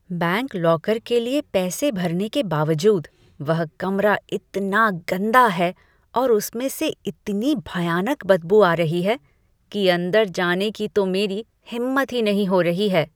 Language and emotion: Hindi, disgusted